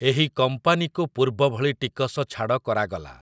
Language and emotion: Odia, neutral